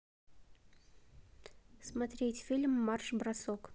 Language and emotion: Russian, neutral